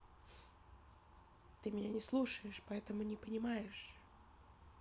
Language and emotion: Russian, sad